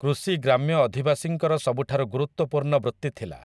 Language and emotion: Odia, neutral